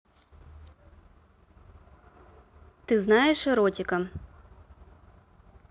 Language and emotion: Russian, neutral